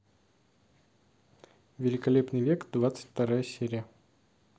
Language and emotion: Russian, neutral